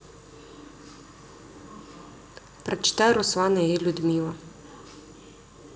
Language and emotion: Russian, neutral